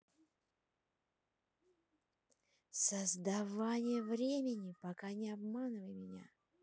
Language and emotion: Russian, neutral